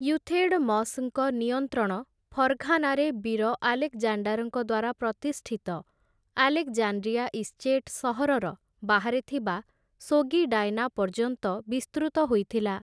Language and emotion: Odia, neutral